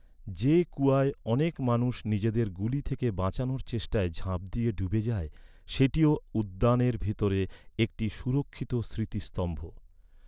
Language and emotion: Bengali, neutral